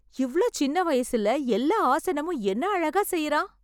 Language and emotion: Tamil, surprised